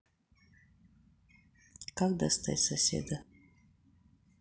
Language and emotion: Russian, neutral